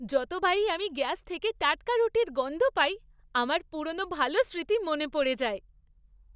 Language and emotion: Bengali, happy